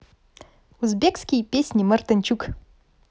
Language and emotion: Russian, positive